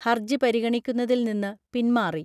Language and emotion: Malayalam, neutral